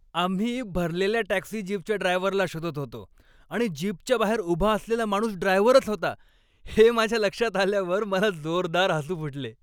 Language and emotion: Marathi, happy